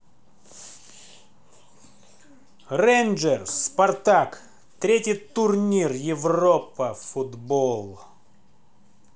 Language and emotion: Russian, angry